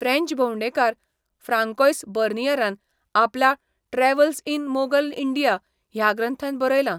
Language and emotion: Goan Konkani, neutral